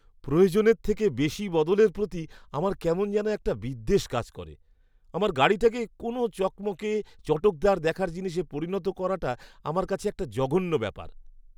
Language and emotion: Bengali, disgusted